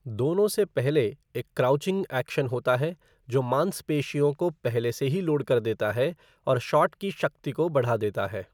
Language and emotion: Hindi, neutral